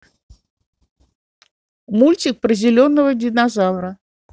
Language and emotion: Russian, neutral